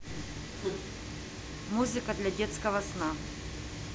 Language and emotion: Russian, neutral